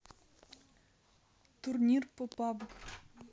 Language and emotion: Russian, neutral